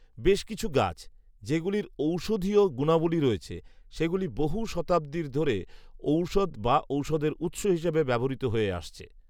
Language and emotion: Bengali, neutral